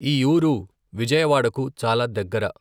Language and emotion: Telugu, neutral